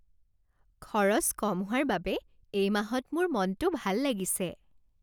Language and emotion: Assamese, happy